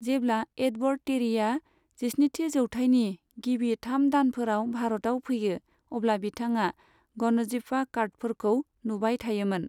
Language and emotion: Bodo, neutral